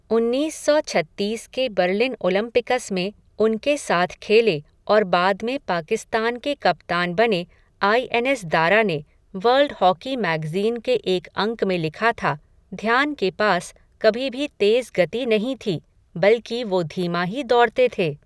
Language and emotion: Hindi, neutral